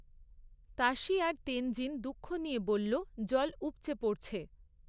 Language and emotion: Bengali, neutral